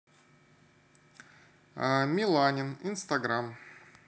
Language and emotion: Russian, neutral